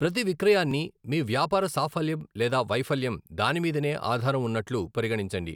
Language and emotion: Telugu, neutral